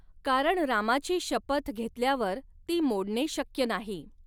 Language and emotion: Marathi, neutral